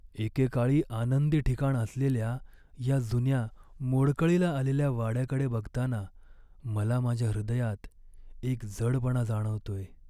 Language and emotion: Marathi, sad